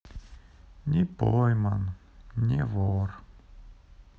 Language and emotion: Russian, sad